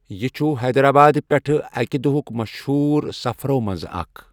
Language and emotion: Kashmiri, neutral